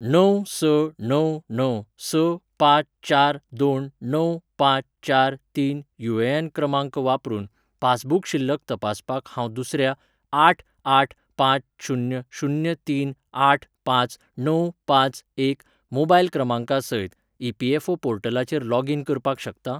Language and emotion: Goan Konkani, neutral